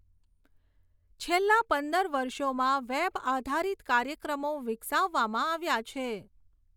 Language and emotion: Gujarati, neutral